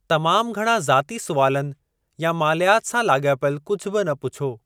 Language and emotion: Sindhi, neutral